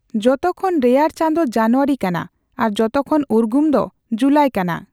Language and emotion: Santali, neutral